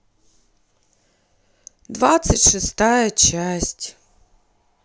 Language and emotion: Russian, sad